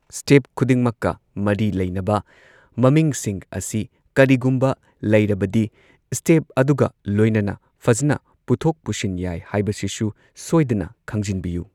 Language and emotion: Manipuri, neutral